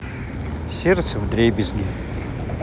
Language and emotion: Russian, sad